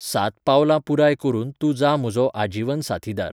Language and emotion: Goan Konkani, neutral